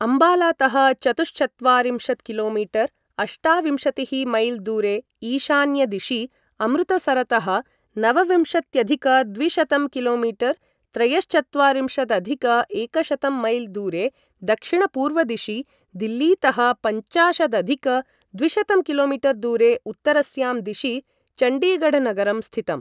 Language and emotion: Sanskrit, neutral